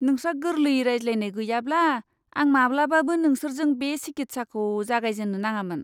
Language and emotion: Bodo, disgusted